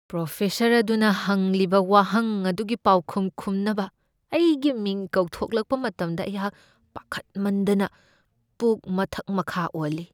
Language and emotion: Manipuri, fearful